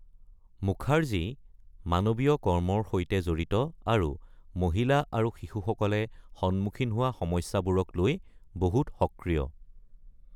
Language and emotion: Assamese, neutral